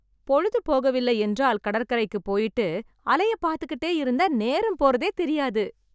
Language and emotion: Tamil, happy